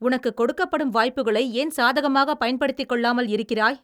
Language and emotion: Tamil, angry